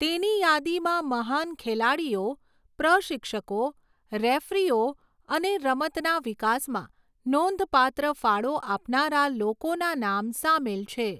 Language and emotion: Gujarati, neutral